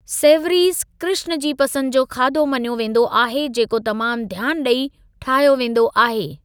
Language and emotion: Sindhi, neutral